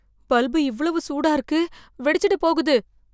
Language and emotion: Tamil, fearful